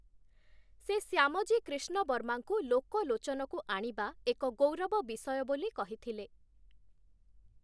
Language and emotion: Odia, neutral